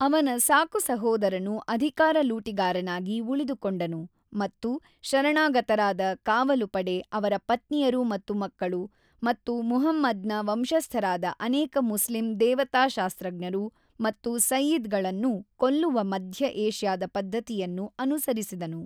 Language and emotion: Kannada, neutral